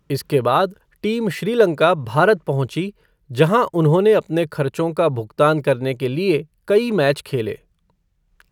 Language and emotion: Hindi, neutral